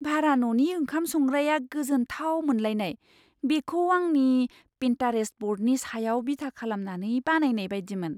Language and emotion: Bodo, surprised